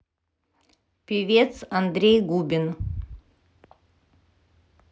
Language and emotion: Russian, neutral